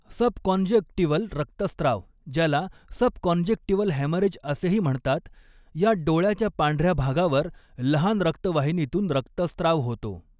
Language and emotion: Marathi, neutral